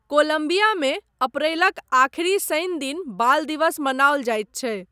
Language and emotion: Maithili, neutral